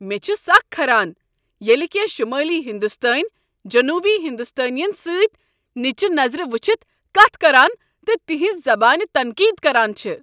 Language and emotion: Kashmiri, angry